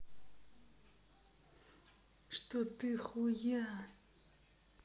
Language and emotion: Russian, angry